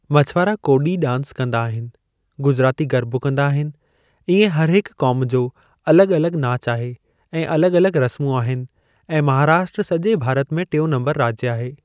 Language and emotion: Sindhi, neutral